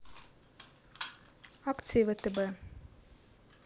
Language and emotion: Russian, neutral